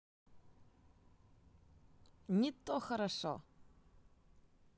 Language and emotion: Russian, positive